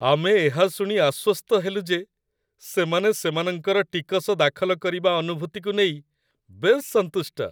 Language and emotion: Odia, happy